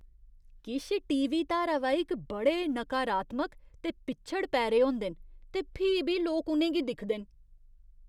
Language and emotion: Dogri, disgusted